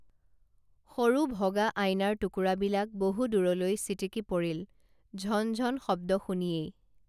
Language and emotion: Assamese, neutral